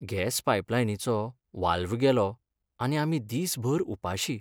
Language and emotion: Goan Konkani, sad